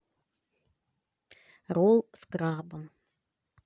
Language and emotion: Russian, neutral